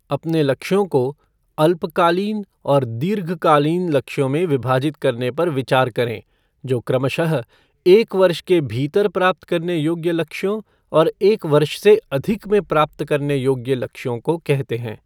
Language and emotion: Hindi, neutral